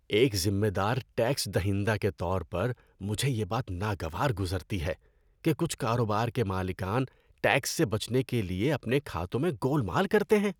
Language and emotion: Urdu, disgusted